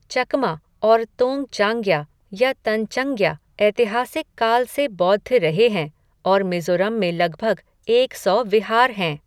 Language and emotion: Hindi, neutral